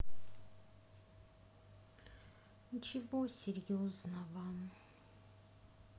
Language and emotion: Russian, sad